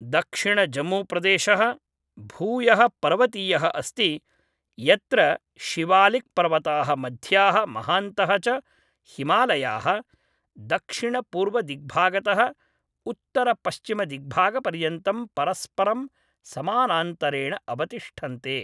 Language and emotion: Sanskrit, neutral